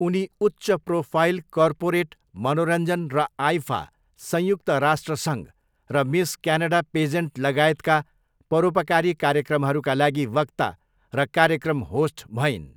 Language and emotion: Nepali, neutral